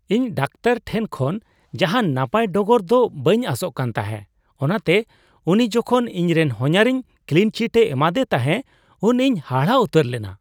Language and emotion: Santali, surprised